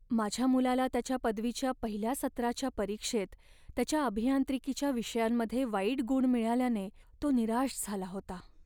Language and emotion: Marathi, sad